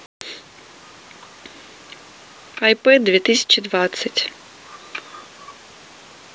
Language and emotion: Russian, neutral